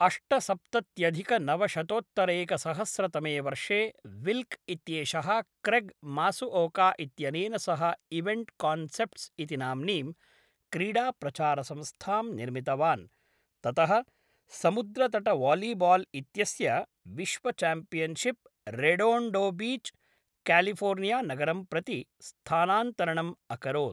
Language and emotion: Sanskrit, neutral